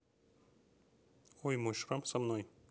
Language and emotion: Russian, neutral